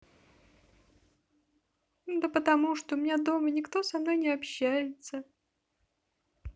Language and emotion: Russian, sad